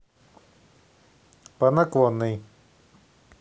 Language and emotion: Russian, neutral